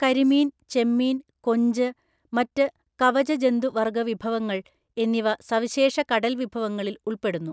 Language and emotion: Malayalam, neutral